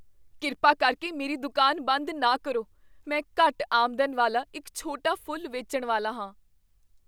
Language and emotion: Punjabi, fearful